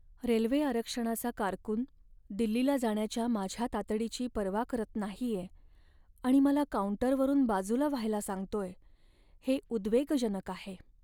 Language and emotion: Marathi, sad